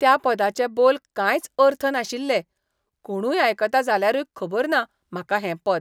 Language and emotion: Goan Konkani, disgusted